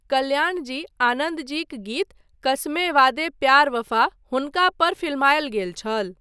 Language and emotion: Maithili, neutral